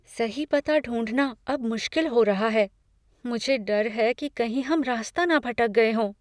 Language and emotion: Hindi, fearful